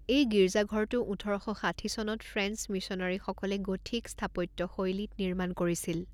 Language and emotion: Assamese, neutral